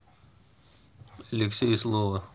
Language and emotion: Russian, neutral